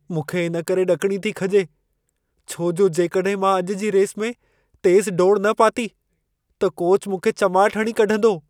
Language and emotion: Sindhi, fearful